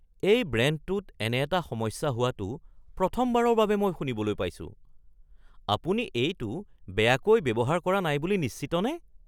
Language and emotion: Assamese, surprised